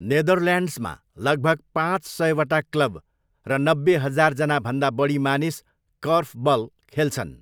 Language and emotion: Nepali, neutral